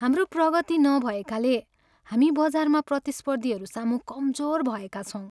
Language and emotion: Nepali, sad